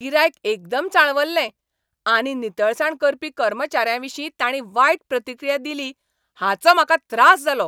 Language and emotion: Goan Konkani, angry